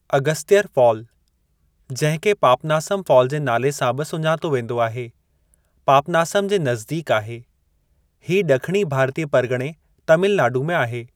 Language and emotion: Sindhi, neutral